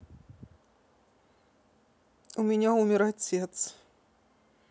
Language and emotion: Russian, sad